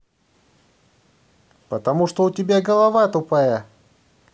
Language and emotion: Russian, angry